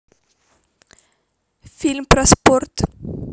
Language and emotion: Russian, neutral